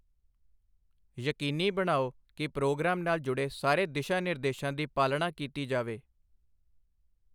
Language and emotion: Punjabi, neutral